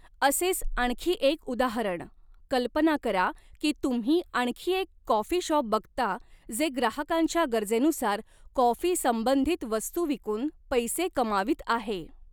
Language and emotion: Marathi, neutral